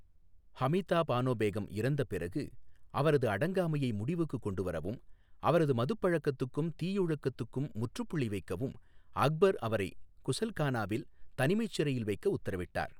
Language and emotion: Tamil, neutral